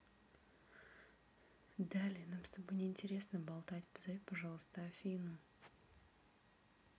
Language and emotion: Russian, angry